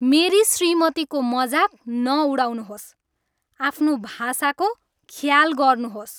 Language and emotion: Nepali, angry